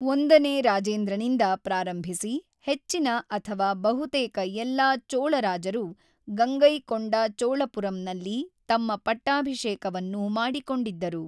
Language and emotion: Kannada, neutral